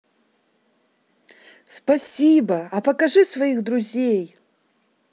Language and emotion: Russian, positive